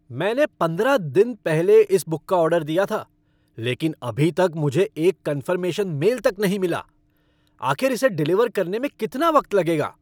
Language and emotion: Hindi, angry